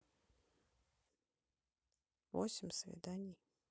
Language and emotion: Russian, neutral